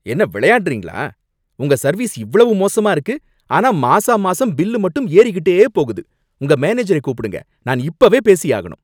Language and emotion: Tamil, angry